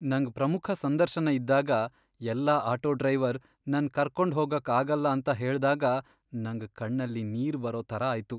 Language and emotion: Kannada, sad